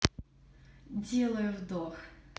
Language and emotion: Russian, neutral